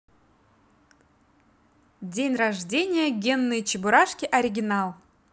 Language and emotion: Russian, positive